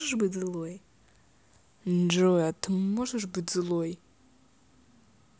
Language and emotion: Russian, neutral